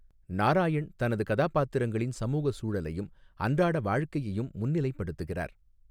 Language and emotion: Tamil, neutral